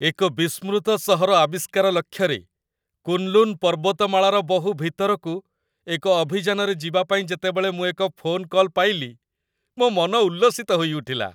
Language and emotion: Odia, happy